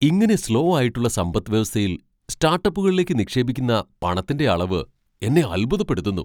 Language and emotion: Malayalam, surprised